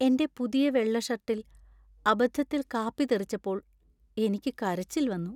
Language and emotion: Malayalam, sad